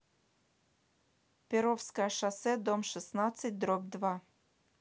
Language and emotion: Russian, neutral